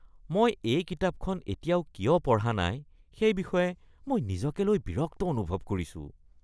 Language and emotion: Assamese, disgusted